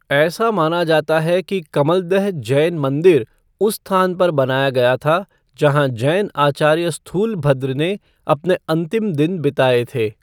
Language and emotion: Hindi, neutral